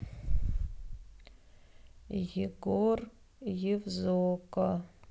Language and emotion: Russian, sad